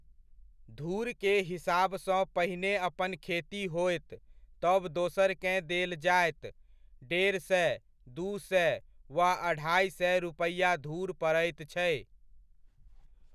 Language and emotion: Maithili, neutral